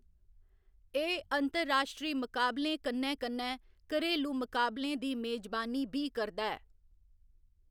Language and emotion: Dogri, neutral